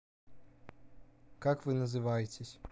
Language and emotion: Russian, neutral